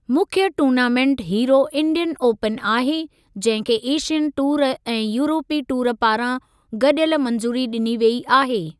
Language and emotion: Sindhi, neutral